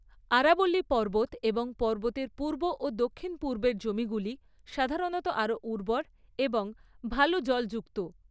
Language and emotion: Bengali, neutral